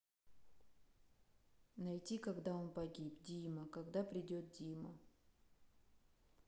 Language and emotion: Russian, sad